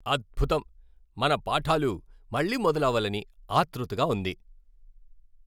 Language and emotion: Telugu, happy